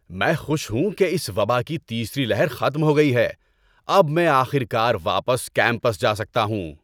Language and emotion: Urdu, happy